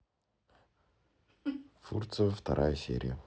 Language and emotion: Russian, neutral